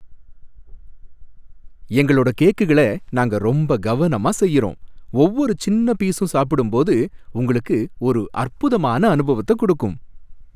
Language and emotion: Tamil, happy